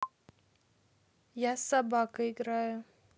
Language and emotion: Russian, neutral